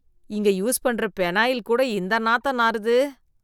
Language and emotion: Tamil, disgusted